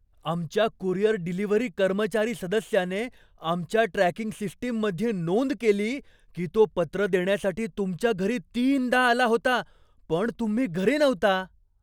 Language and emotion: Marathi, surprised